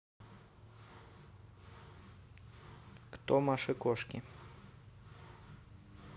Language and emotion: Russian, neutral